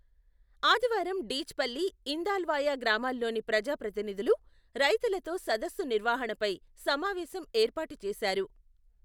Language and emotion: Telugu, neutral